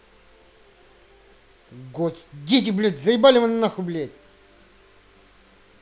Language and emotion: Russian, angry